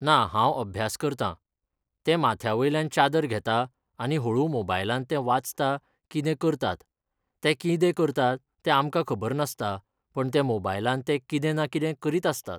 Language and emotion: Goan Konkani, neutral